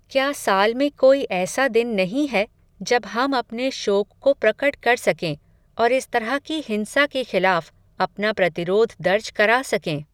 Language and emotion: Hindi, neutral